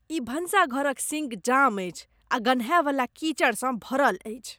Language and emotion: Maithili, disgusted